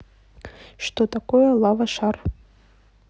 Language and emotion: Russian, neutral